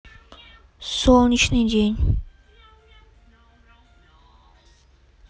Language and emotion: Russian, neutral